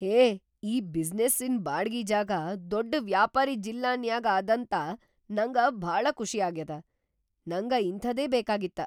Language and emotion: Kannada, surprised